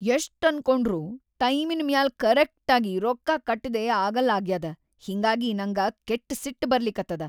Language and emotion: Kannada, angry